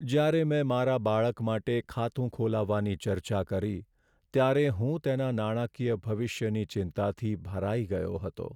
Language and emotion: Gujarati, sad